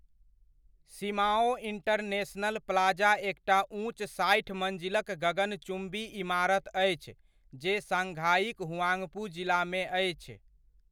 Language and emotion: Maithili, neutral